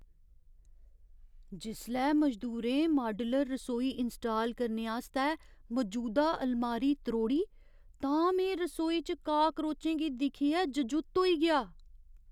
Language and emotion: Dogri, surprised